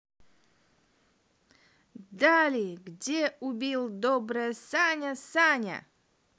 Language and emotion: Russian, positive